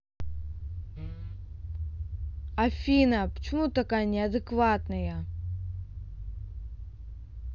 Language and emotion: Russian, angry